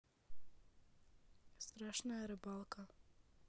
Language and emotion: Russian, neutral